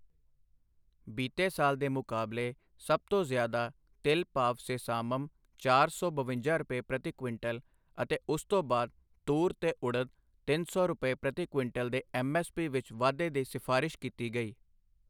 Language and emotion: Punjabi, neutral